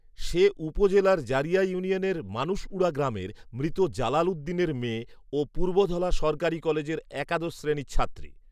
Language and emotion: Bengali, neutral